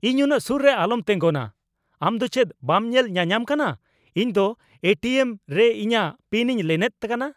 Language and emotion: Santali, angry